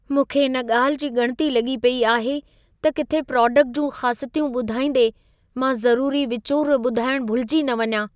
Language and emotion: Sindhi, fearful